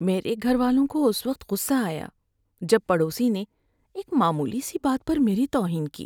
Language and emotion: Urdu, sad